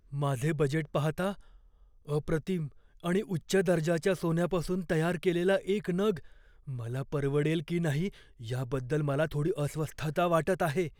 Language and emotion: Marathi, fearful